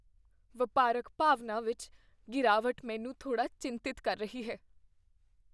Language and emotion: Punjabi, fearful